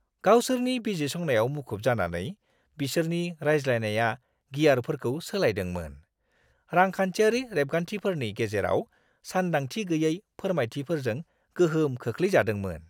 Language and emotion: Bodo, surprised